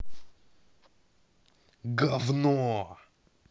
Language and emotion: Russian, angry